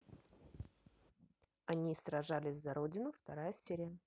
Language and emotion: Russian, neutral